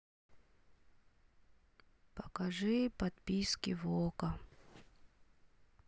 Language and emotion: Russian, sad